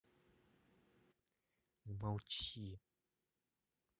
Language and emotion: Russian, angry